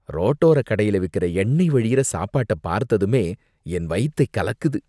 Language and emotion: Tamil, disgusted